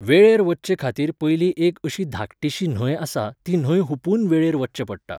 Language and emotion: Goan Konkani, neutral